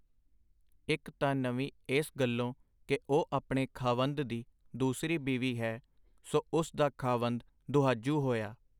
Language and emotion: Punjabi, neutral